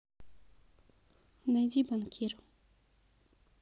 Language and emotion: Russian, neutral